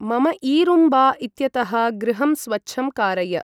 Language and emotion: Sanskrit, neutral